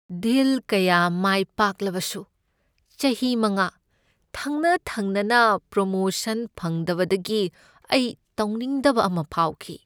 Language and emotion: Manipuri, sad